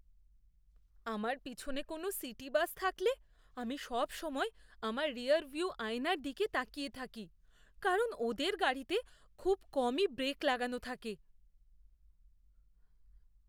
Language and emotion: Bengali, fearful